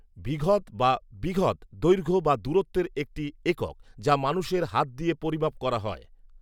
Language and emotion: Bengali, neutral